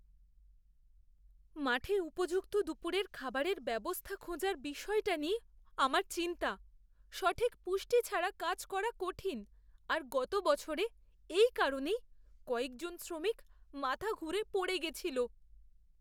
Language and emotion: Bengali, fearful